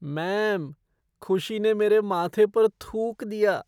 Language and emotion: Hindi, disgusted